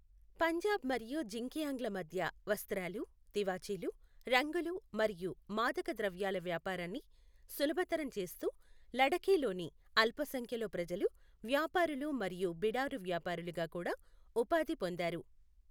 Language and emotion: Telugu, neutral